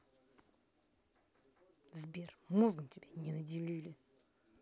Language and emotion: Russian, angry